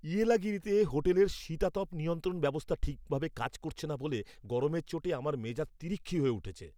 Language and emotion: Bengali, angry